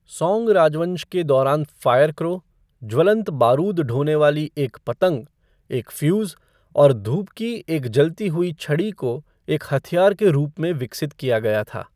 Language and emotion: Hindi, neutral